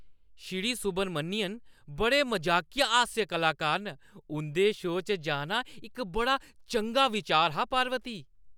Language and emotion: Dogri, happy